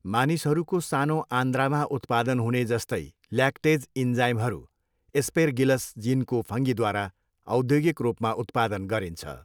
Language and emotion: Nepali, neutral